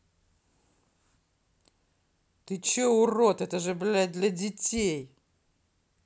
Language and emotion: Russian, angry